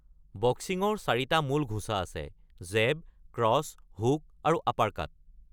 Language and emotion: Assamese, neutral